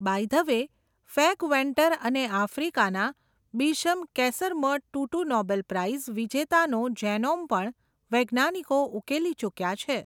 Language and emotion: Gujarati, neutral